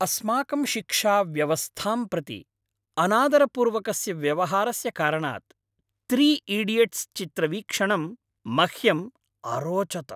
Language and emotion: Sanskrit, happy